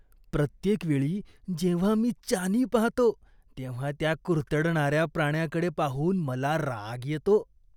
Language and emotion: Marathi, disgusted